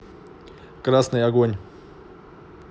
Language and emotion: Russian, neutral